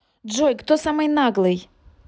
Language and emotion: Russian, angry